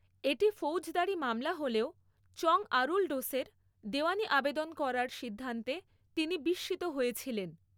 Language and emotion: Bengali, neutral